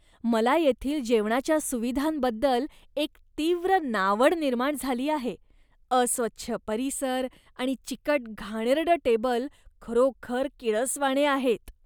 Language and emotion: Marathi, disgusted